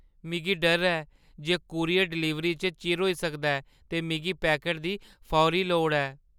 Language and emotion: Dogri, fearful